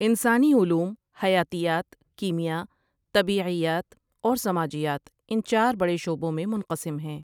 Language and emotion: Urdu, neutral